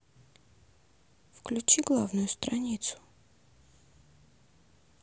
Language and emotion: Russian, neutral